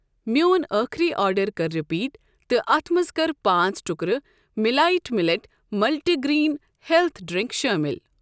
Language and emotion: Kashmiri, neutral